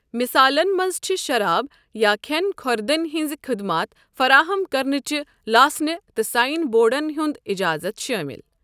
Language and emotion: Kashmiri, neutral